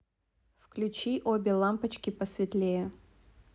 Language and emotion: Russian, neutral